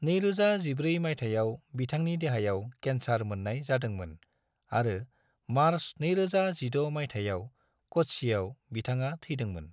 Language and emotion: Bodo, neutral